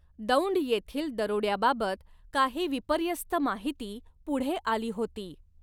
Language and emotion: Marathi, neutral